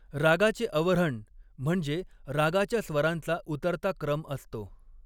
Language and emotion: Marathi, neutral